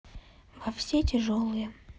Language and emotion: Russian, sad